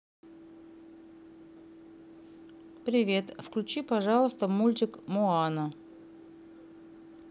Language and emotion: Russian, neutral